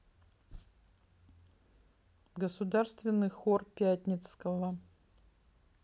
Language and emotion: Russian, neutral